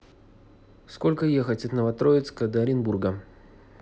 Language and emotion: Russian, neutral